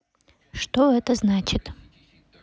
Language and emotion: Russian, neutral